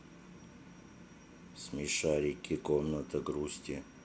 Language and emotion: Russian, sad